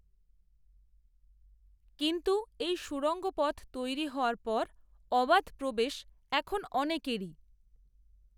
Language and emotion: Bengali, neutral